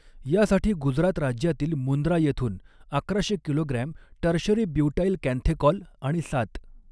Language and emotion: Marathi, neutral